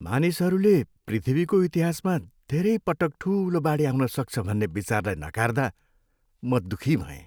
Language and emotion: Nepali, sad